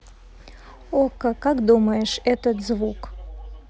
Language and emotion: Russian, neutral